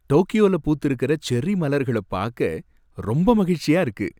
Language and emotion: Tamil, happy